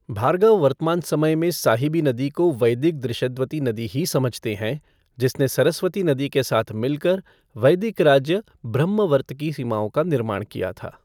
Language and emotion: Hindi, neutral